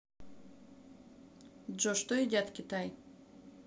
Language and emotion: Russian, neutral